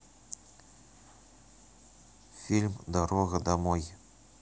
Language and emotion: Russian, neutral